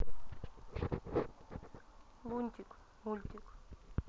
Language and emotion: Russian, neutral